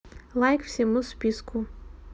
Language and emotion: Russian, neutral